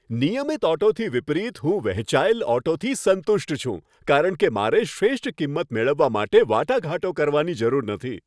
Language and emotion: Gujarati, happy